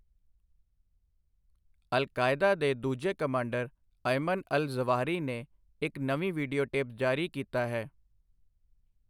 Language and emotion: Punjabi, neutral